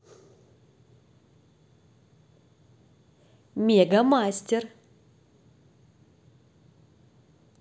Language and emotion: Russian, positive